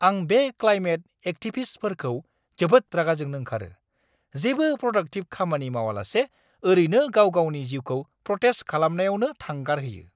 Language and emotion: Bodo, angry